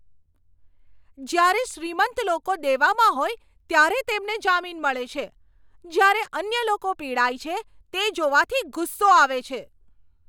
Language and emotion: Gujarati, angry